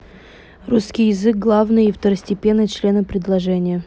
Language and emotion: Russian, neutral